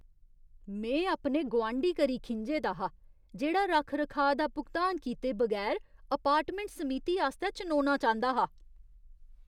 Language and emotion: Dogri, disgusted